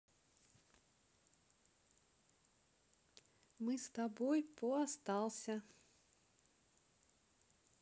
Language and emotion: Russian, neutral